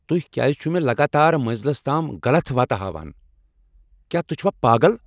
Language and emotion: Kashmiri, angry